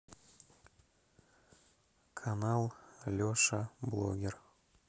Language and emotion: Russian, neutral